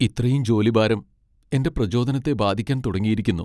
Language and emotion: Malayalam, sad